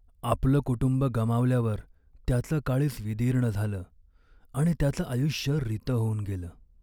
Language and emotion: Marathi, sad